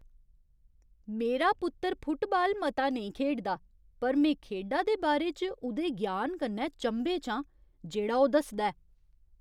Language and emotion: Dogri, surprised